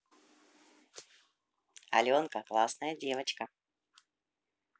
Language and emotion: Russian, positive